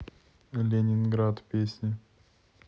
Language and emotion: Russian, neutral